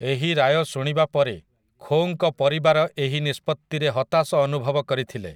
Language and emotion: Odia, neutral